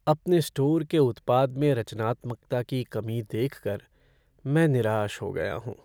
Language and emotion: Hindi, sad